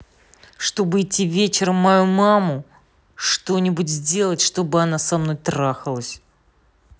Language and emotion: Russian, angry